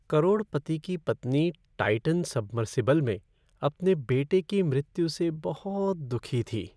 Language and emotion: Hindi, sad